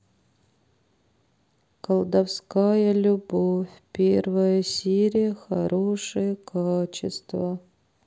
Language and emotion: Russian, sad